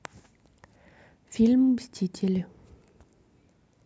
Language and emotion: Russian, neutral